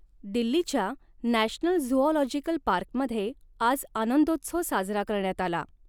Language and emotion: Marathi, neutral